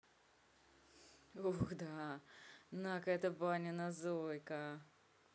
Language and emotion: Russian, neutral